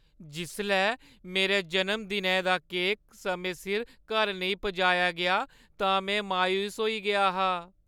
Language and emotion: Dogri, sad